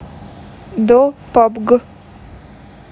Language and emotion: Russian, neutral